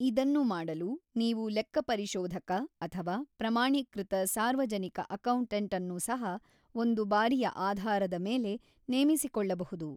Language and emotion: Kannada, neutral